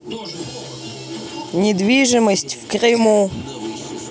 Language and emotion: Russian, neutral